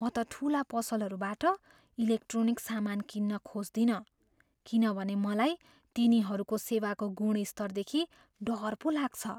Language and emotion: Nepali, fearful